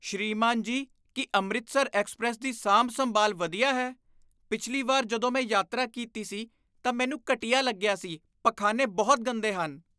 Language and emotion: Punjabi, disgusted